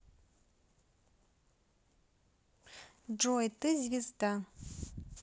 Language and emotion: Russian, neutral